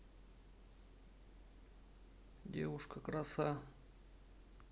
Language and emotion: Russian, neutral